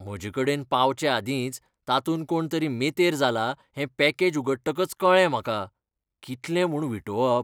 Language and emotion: Goan Konkani, disgusted